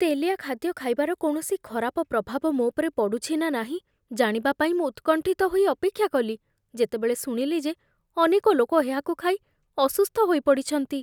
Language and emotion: Odia, fearful